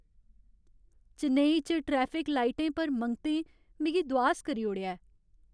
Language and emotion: Dogri, sad